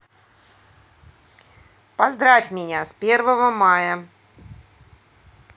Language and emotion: Russian, neutral